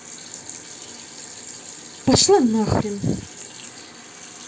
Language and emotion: Russian, angry